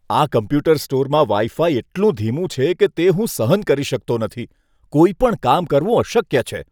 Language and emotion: Gujarati, disgusted